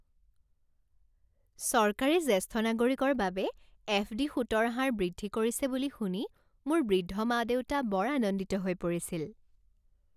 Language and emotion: Assamese, happy